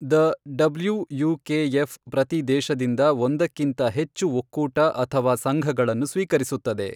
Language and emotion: Kannada, neutral